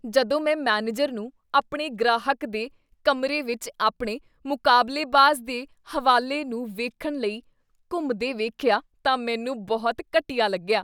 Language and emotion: Punjabi, disgusted